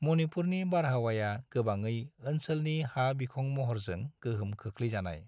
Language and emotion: Bodo, neutral